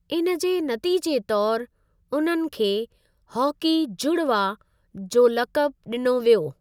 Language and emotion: Sindhi, neutral